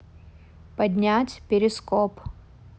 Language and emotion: Russian, neutral